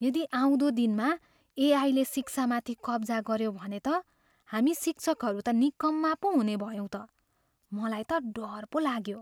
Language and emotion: Nepali, fearful